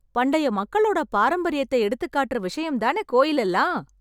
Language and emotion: Tamil, happy